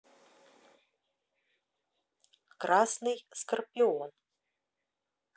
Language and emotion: Russian, neutral